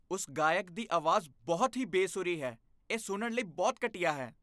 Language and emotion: Punjabi, disgusted